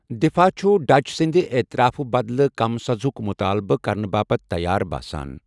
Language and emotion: Kashmiri, neutral